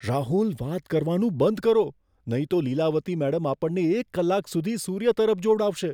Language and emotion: Gujarati, fearful